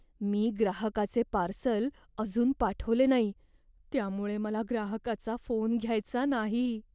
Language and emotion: Marathi, fearful